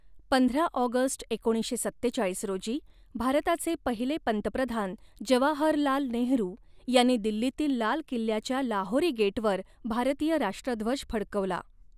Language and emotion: Marathi, neutral